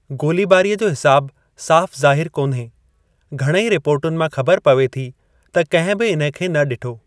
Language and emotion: Sindhi, neutral